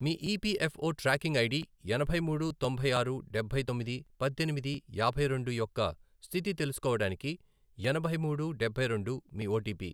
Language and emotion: Telugu, neutral